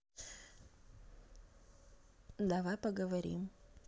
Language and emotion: Russian, neutral